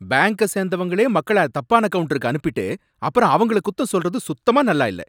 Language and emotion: Tamil, angry